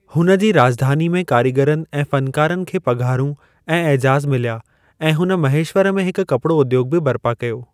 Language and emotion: Sindhi, neutral